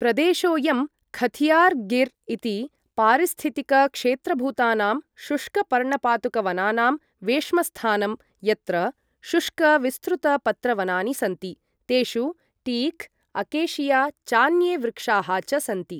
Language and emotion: Sanskrit, neutral